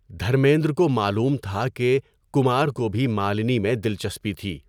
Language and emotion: Urdu, neutral